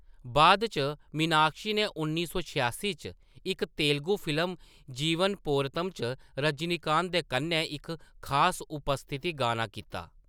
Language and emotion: Dogri, neutral